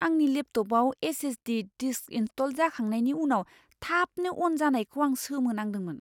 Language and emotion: Bodo, surprised